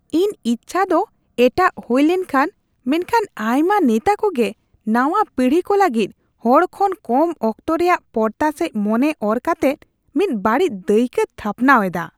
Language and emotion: Santali, disgusted